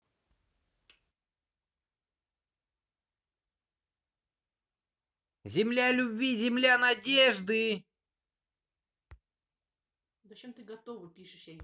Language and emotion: Russian, positive